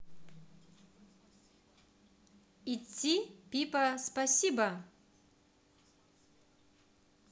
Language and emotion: Russian, positive